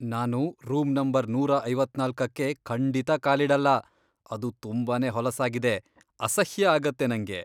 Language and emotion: Kannada, disgusted